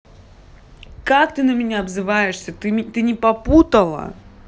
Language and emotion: Russian, angry